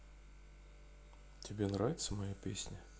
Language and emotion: Russian, neutral